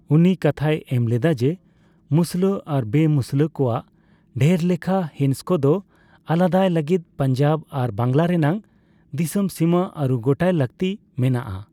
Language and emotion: Santali, neutral